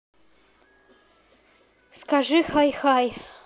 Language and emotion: Russian, neutral